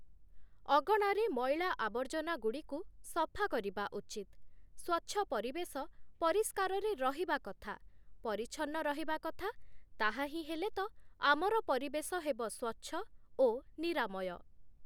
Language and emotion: Odia, neutral